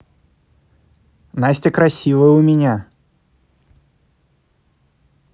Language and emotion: Russian, positive